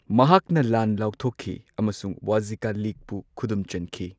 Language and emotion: Manipuri, neutral